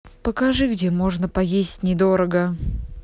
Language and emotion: Russian, neutral